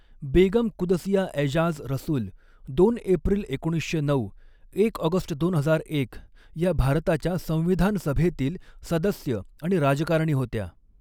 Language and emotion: Marathi, neutral